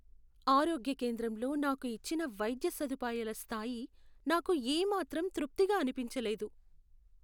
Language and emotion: Telugu, sad